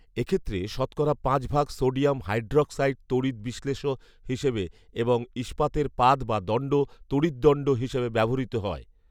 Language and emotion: Bengali, neutral